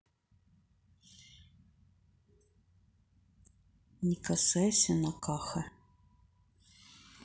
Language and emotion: Russian, neutral